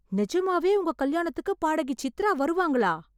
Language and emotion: Tamil, surprised